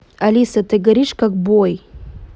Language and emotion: Russian, neutral